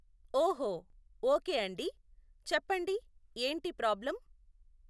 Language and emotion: Telugu, neutral